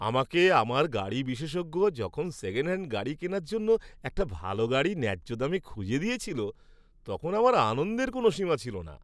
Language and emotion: Bengali, happy